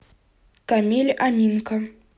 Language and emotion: Russian, neutral